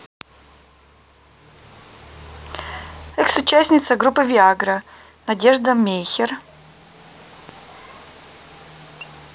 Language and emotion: Russian, neutral